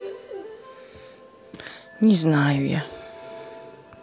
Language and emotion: Russian, sad